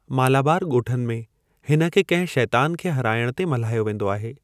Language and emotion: Sindhi, neutral